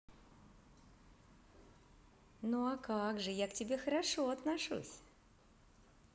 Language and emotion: Russian, positive